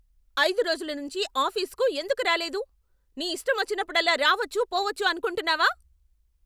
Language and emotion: Telugu, angry